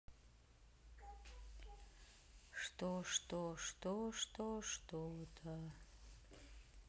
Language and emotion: Russian, sad